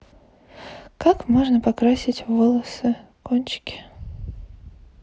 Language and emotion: Russian, neutral